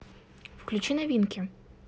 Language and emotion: Russian, neutral